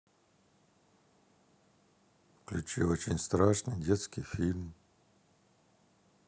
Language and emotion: Russian, neutral